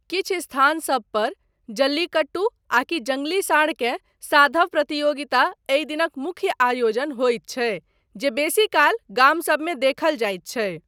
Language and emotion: Maithili, neutral